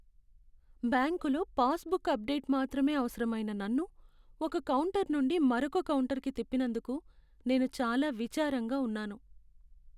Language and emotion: Telugu, sad